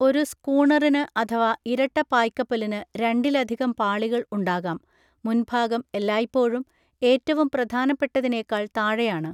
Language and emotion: Malayalam, neutral